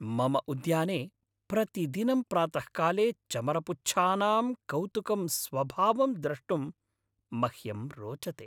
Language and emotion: Sanskrit, happy